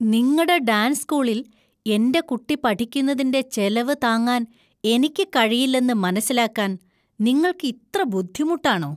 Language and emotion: Malayalam, disgusted